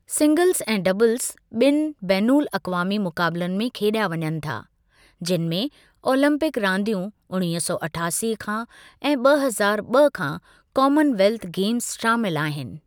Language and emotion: Sindhi, neutral